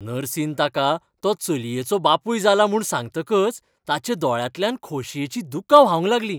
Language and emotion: Goan Konkani, happy